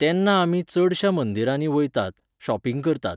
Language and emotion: Goan Konkani, neutral